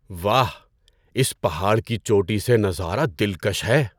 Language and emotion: Urdu, surprised